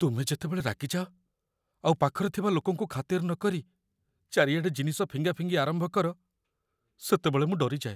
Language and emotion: Odia, fearful